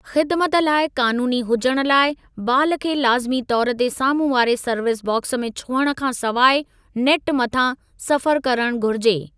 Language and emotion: Sindhi, neutral